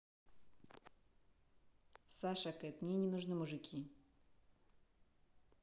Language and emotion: Russian, neutral